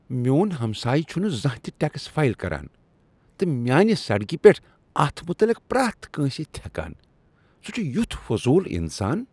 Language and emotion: Kashmiri, disgusted